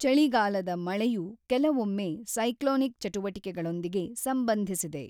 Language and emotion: Kannada, neutral